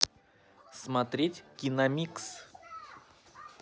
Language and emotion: Russian, neutral